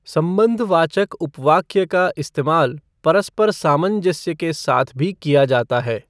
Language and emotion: Hindi, neutral